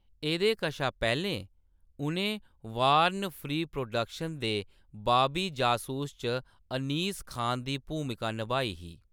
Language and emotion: Dogri, neutral